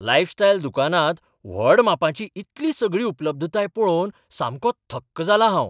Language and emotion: Goan Konkani, surprised